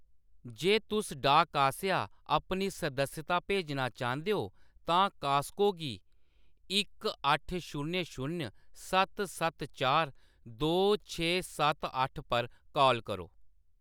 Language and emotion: Dogri, neutral